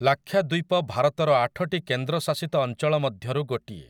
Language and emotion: Odia, neutral